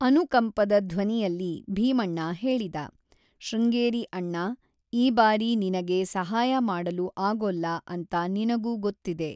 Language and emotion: Kannada, neutral